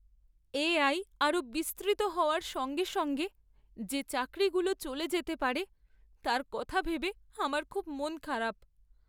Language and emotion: Bengali, sad